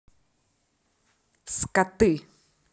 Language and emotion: Russian, angry